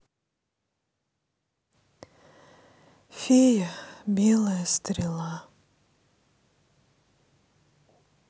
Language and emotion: Russian, sad